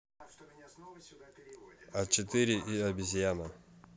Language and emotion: Russian, neutral